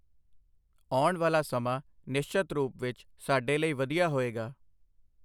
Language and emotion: Punjabi, neutral